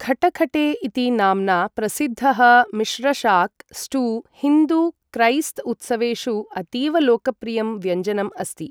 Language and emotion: Sanskrit, neutral